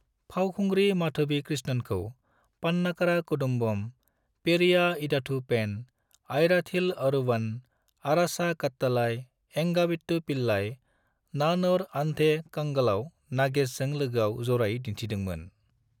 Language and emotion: Bodo, neutral